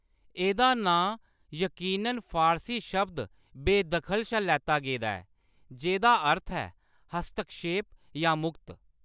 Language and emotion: Dogri, neutral